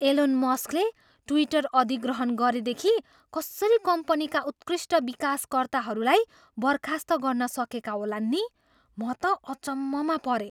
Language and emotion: Nepali, surprised